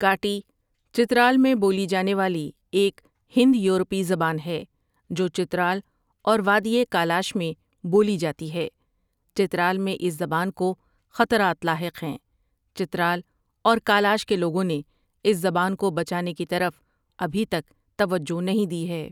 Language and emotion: Urdu, neutral